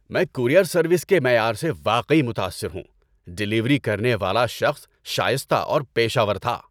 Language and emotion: Urdu, happy